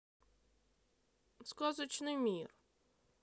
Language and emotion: Russian, sad